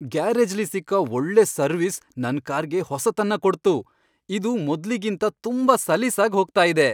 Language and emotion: Kannada, happy